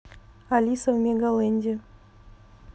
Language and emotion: Russian, neutral